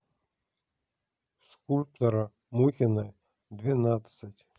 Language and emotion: Russian, neutral